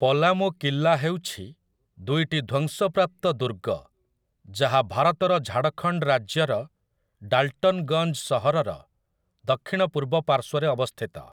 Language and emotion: Odia, neutral